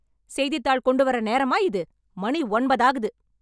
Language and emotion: Tamil, angry